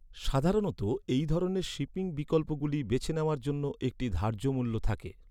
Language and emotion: Bengali, neutral